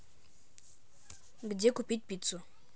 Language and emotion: Russian, neutral